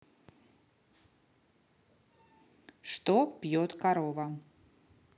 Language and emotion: Russian, neutral